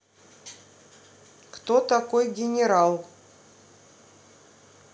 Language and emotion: Russian, neutral